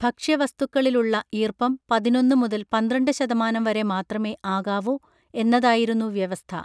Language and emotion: Malayalam, neutral